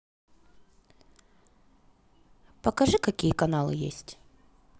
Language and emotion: Russian, neutral